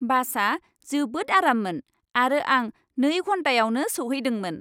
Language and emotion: Bodo, happy